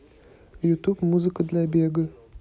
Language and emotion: Russian, neutral